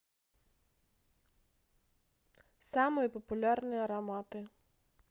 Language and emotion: Russian, neutral